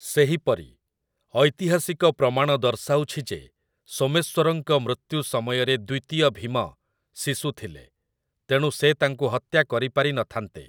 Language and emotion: Odia, neutral